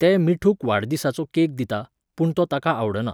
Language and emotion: Goan Konkani, neutral